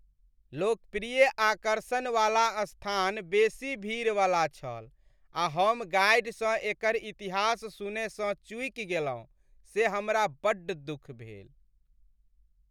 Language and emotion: Maithili, sad